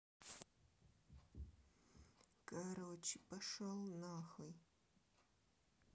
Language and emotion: Russian, angry